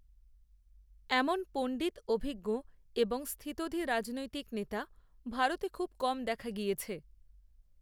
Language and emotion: Bengali, neutral